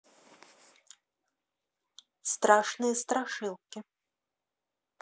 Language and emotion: Russian, neutral